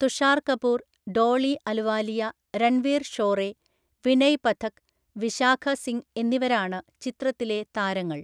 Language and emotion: Malayalam, neutral